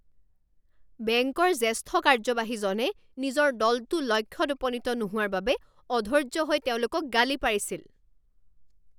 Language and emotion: Assamese, angry